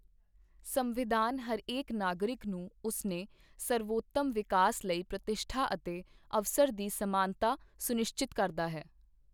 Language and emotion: Punjabi, neutral